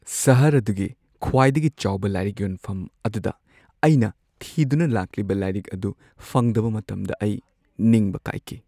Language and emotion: Manipuri, sad